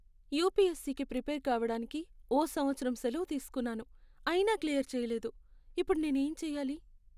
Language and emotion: Telugu, sad